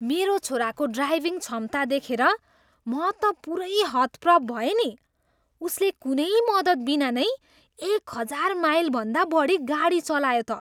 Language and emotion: Nepali, surprised